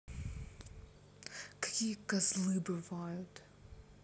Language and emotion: Russian, angry